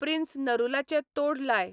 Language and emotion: Goan Konkani, neutral